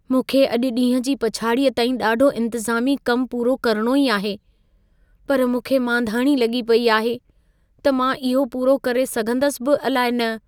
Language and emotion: Sindhi, fearful